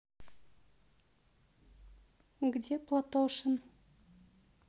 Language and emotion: Russian, neutral